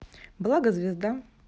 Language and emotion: Russian, neutral